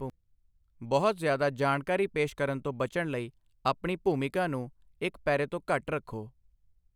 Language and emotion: Punjabi, neutral